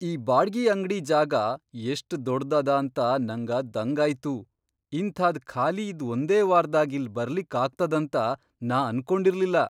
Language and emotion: Kannada, surprised